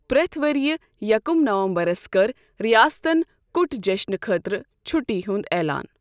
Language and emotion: Kashmiri, neutral